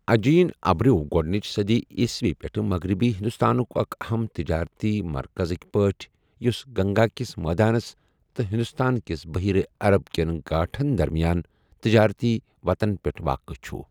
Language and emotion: Kashmiri, neutral